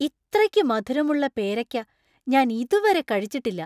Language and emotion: Malayalam, surprised